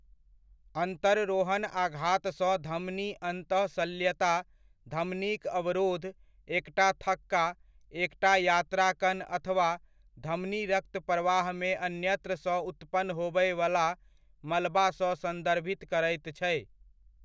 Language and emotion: Maithili, neutral